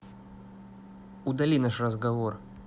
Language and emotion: Russian, angry